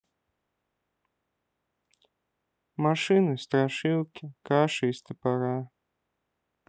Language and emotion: Russian, sad